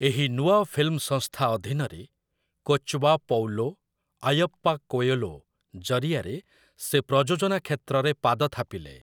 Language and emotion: Odia, neutral